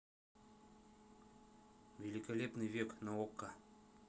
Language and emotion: Russian, neutral